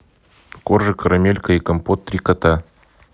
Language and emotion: Russian, neutral